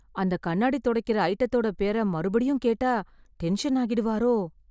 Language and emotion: Tamil, fearful